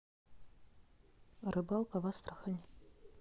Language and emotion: Russian, neutral